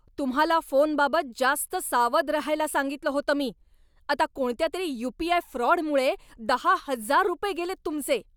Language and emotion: Marathi, angry